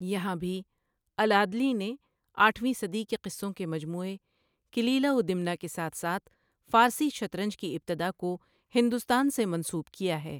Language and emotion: Urdu, neutral